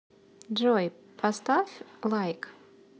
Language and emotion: Russian, positive